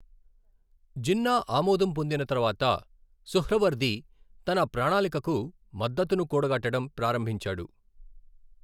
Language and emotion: Telugu, neutral